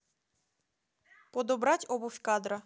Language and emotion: Russian, neutral